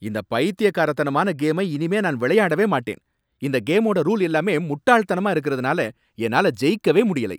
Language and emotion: Tamil, angry